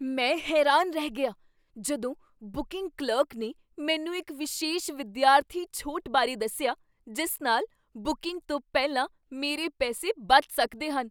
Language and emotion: Punjabi, surprised